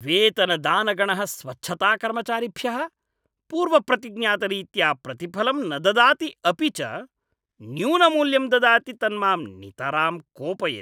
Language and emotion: Sanskrit, angry